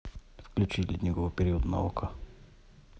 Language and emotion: Russian, neutral